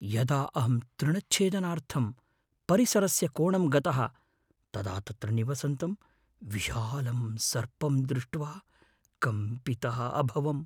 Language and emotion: Sanskrit, fearful